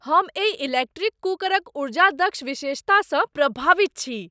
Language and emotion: Maithili, surprised